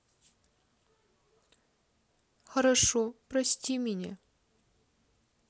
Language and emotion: Russian, sad